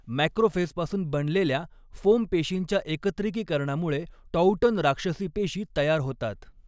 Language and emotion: Marathi, neutral